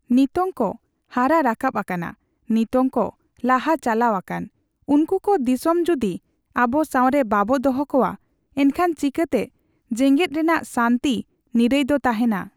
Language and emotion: Santali, neutral